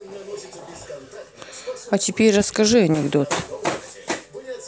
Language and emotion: Russian, neutral